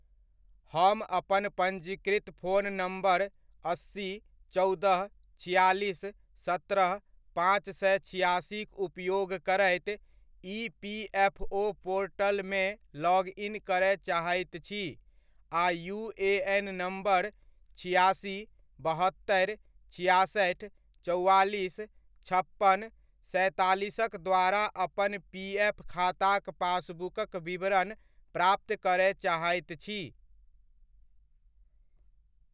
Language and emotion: Maithili, neutral